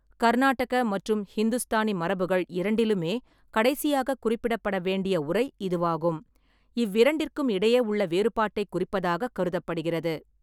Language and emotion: Tamil, neutral